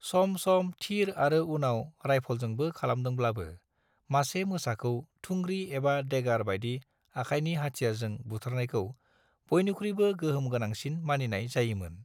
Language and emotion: Bodo, neutral